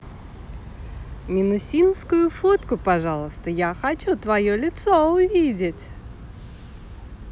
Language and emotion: Russian, positive